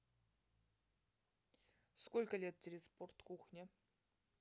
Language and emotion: Russian, neutral